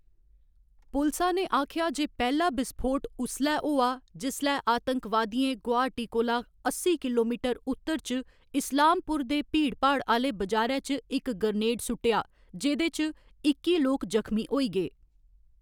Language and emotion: Dogri, neutral